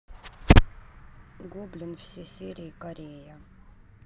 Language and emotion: Russian, neutral